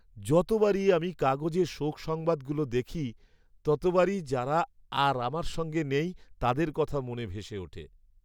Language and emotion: Bengali, sad